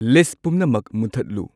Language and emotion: Manipuri, neutral